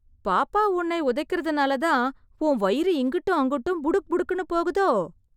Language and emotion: Tamil, surprised